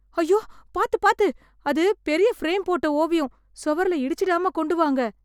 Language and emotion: Tamil, fearful